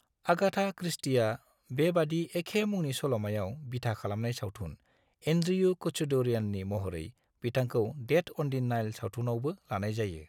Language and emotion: Bodo, neutral